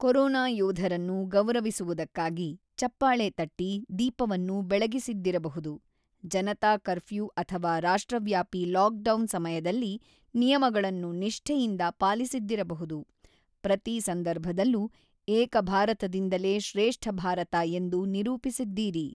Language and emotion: Kannada, neutral